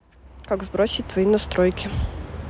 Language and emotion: Russian, neutral